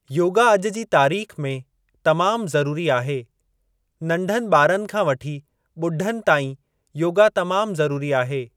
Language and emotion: Sindhi, neutral